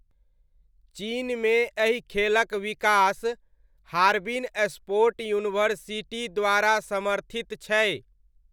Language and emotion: Maithili, neutral